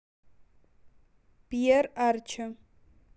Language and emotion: Russian, neutral